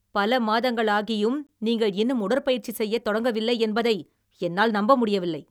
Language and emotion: Tamil, angry